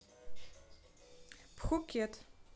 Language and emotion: Russian, neutral